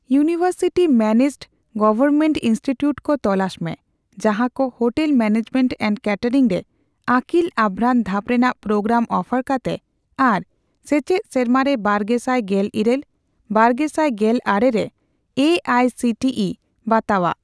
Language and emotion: Santali, neutral